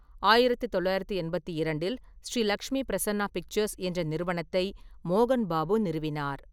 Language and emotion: Tamil, neutral